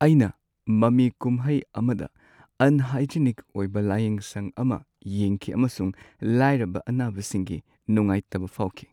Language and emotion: Manipuri, sad